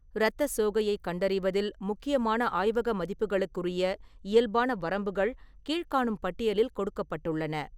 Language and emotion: Tamil, neutral